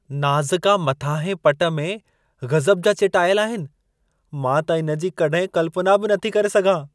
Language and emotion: Sindhi, surprised